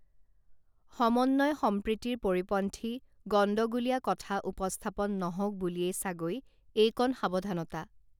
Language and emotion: Assamese, neutral